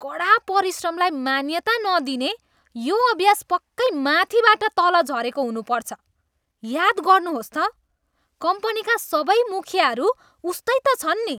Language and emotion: Nepali, disgusted